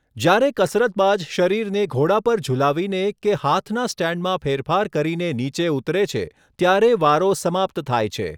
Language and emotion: Gujarati, neutral